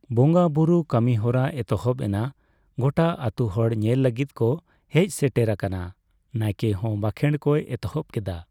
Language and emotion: Santali, neutral